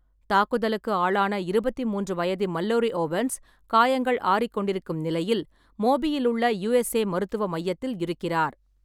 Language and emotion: Tamil, neutral